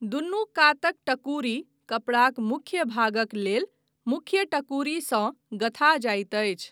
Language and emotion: Maithili, neutral